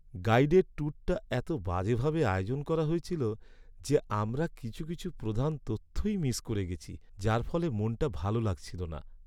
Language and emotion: Bengali, sad